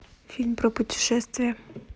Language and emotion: Russian, neutral